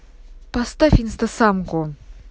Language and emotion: Russian, angry